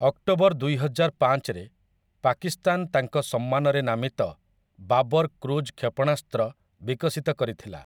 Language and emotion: Odia, neutral